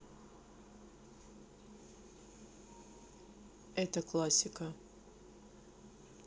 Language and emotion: Russian, neutral